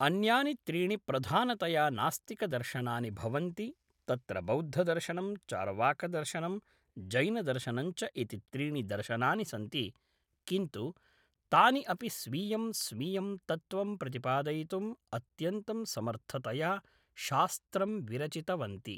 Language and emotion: Sanskrit, neutral